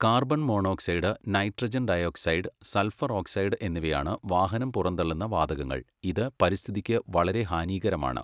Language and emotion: Malayalam, neutral